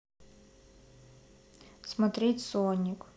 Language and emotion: Russian, neutral